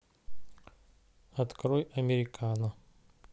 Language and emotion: Russian, neutral